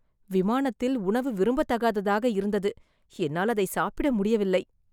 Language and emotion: Tamil, disgusted